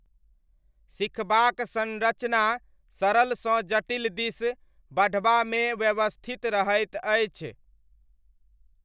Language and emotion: Maithili, neutral